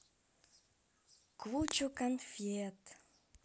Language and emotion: Russian, positive